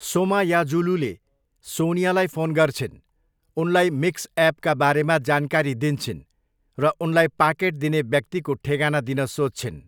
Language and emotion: Nepali, neutral